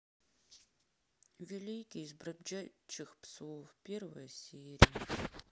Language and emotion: Russian, sad